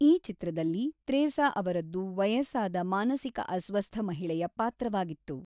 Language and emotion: Kannada, neutral